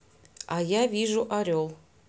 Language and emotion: Russian, neutral